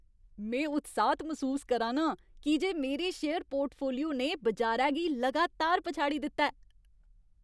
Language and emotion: Dogri, happy